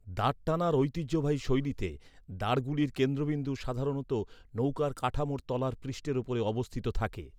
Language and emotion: Bengali, neutral